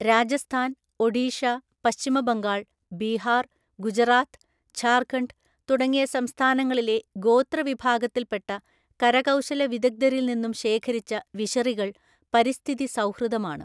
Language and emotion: Malayalam, neutral